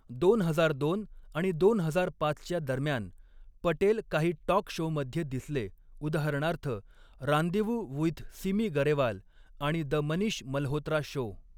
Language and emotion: Marathi, neutral